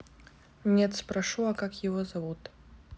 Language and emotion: Russian, neutral